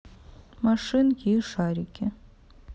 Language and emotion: Russian, neutral